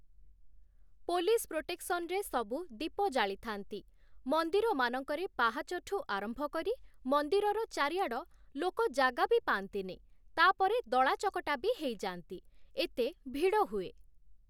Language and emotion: Odia, neutral